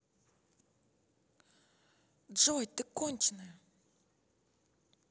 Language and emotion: Russian, angry